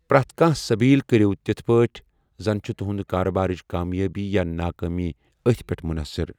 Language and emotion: Kashmiri, neutral